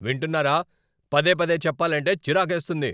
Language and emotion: Telugu, angry